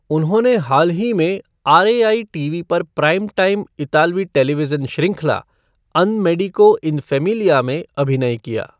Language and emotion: Hindi, neutral